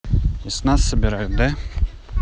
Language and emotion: Russian, neutral